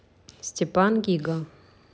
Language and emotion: Russian, neutral